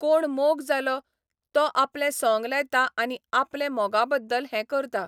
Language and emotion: Goan Konkani, neutral